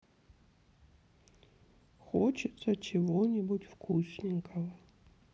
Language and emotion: Russian, sad